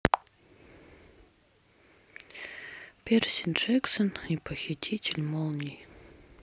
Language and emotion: Russian, sad